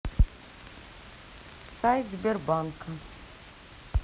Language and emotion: Russian, neutral